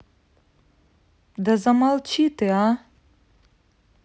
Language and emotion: Russian, angry